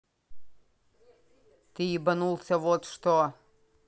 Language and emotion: Russian, angry